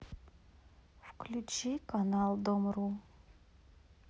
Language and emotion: Russian, sad